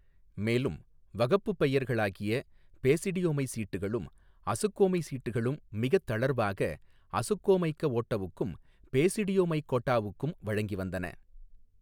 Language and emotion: Tamil, neutral